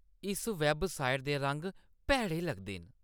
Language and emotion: Dogri, disgusted